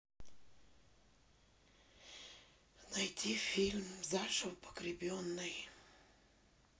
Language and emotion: Russian, sad